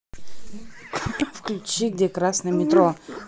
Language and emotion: Russian, neutral